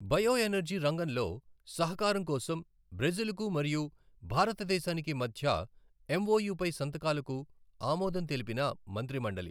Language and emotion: Telugu, neutral